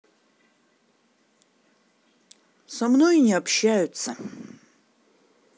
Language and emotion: Russian, neutral